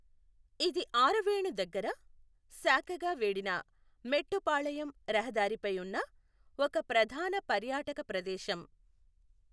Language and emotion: Telugu, neutral